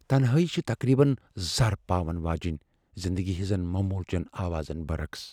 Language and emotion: Kashmiri, fearful